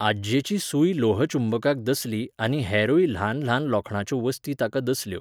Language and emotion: Goan Konkani, neutral